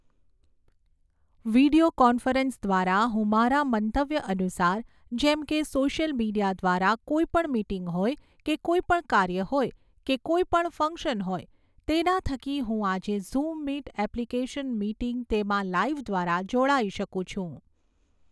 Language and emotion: Gujarati, neutral